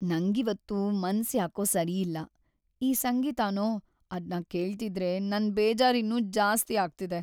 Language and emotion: Kannada, sad